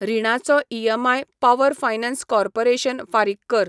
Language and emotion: Goan Konkani, neutral